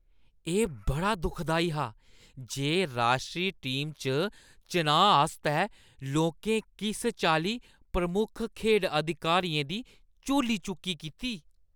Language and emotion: Dogri, disgusted